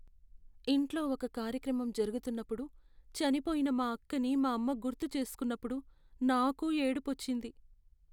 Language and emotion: Telugu, sad